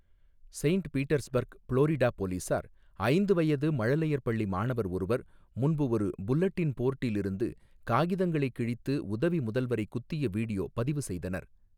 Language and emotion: Tamil, neutral